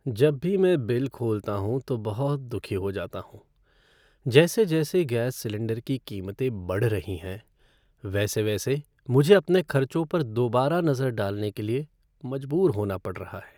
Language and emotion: Hindi, sad